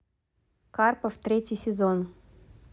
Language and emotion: Russian, neutral